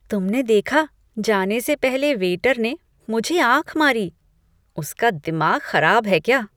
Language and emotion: Hindi, disgusted